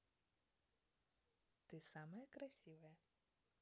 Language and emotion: Russian, positive